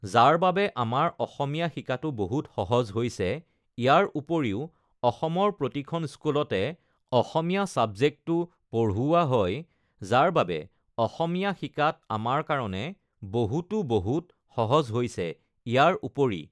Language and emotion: Assamese, neutral